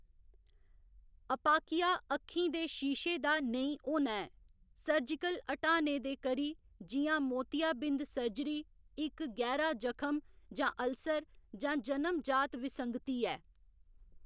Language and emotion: Dogri, neutral